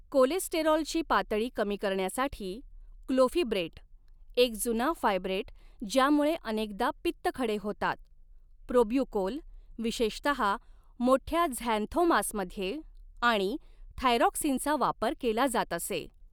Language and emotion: Marathi, neutral